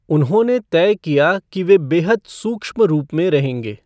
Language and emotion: Hindi, neutral